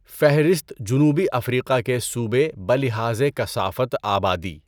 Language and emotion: Urdu, neutral